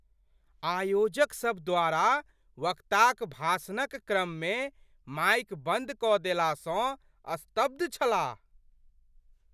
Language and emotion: Maithili, surprised